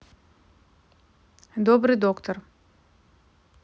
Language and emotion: Russian, neutral